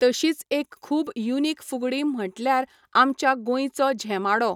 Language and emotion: Goan Konkani, neutral